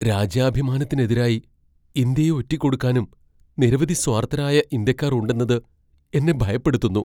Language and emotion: Malayalam, fearful